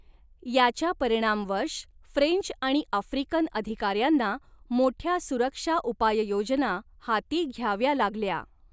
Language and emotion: Marathi, neutral